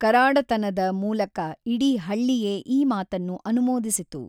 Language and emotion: Kannada, neutral